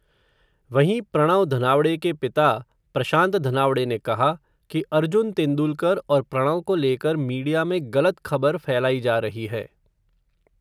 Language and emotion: Hindi, neutral